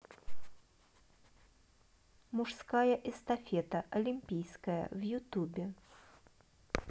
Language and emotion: Russian, neutral